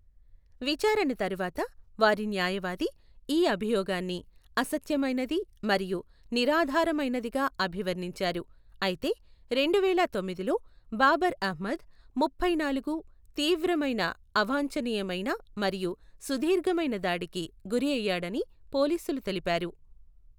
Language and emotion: Telugu, neutral